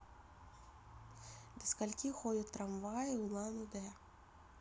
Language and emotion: Russian, neutral